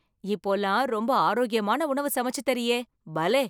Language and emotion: Tamil, surprised